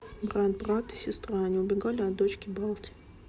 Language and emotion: Russian, neutral